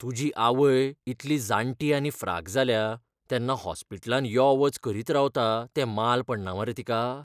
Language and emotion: Goan Konkani, fearful